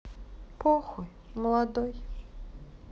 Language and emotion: Russian, sad